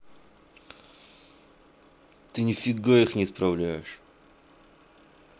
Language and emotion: Russian, angry